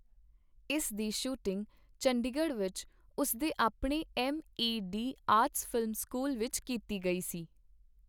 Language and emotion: Punjabi, neutral